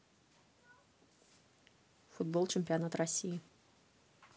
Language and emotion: Russian, neutral